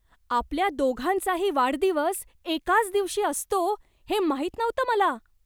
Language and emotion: Marathi, surprised